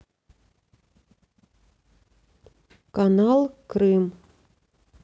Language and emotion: Russian, neutral